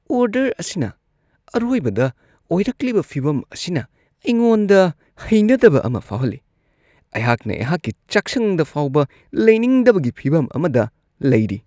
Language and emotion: Manipuri, disgusted